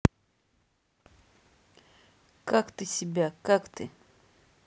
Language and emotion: Russian, neutral